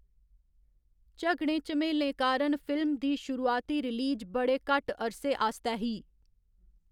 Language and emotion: Dogri, neutral